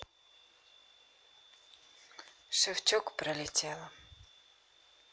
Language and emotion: Russian, sad